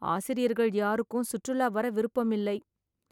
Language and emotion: Tamil, sad